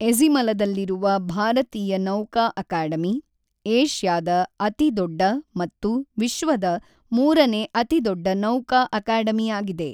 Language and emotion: Kannada, neutral